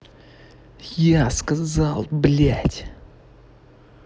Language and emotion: Russian, angry